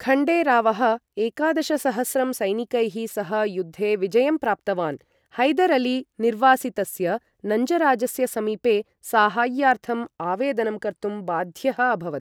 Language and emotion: Sanskrit, neutral